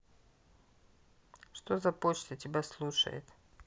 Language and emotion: Russian, neutral